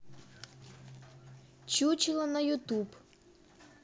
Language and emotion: Russian, neutral